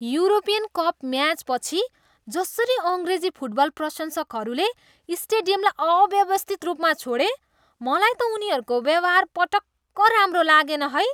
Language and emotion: Nepali, disgusted